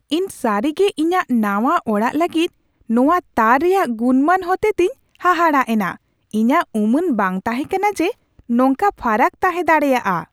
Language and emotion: Santali, surprised